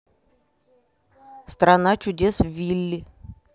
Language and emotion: Russian, neutral